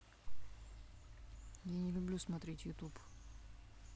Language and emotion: Russian, neutral